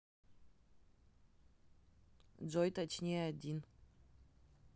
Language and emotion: Russian, neutral